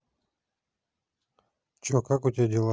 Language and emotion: Russian, neutral